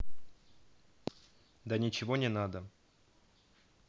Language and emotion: Russian, neutral